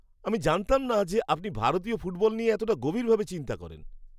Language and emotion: Bengali, surprised